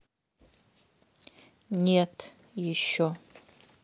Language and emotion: Russian, neutral